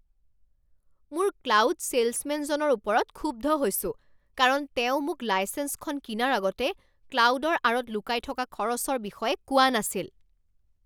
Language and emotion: Assamese, angry